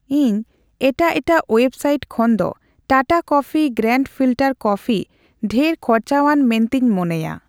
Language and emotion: Santali, neutral